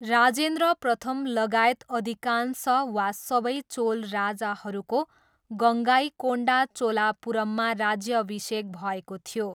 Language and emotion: Nepali, neutral